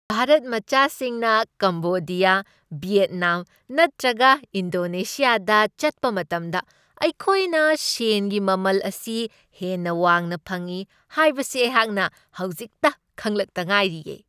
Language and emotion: Manipuri, happy